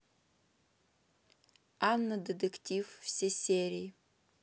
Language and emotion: Russian, neutral